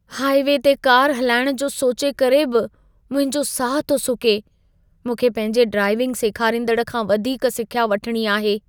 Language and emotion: Sindhi, fearful